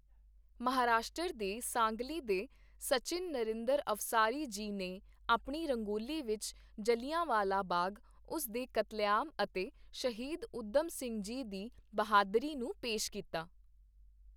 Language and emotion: Punjabi, neutral